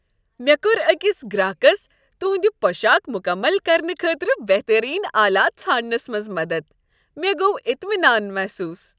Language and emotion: Kashmiri, happy